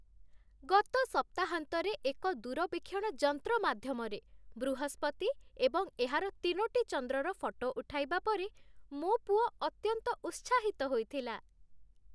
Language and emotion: Odia, happy